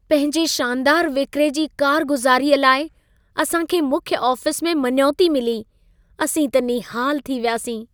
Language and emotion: Sindhi, happy